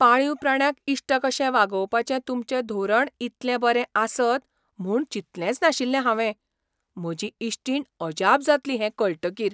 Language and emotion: Goan Konkani, surprised